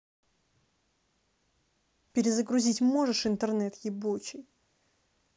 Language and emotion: Russian, angry